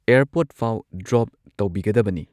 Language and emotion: Manipuri, neutral